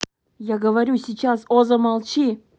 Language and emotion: Russian, angry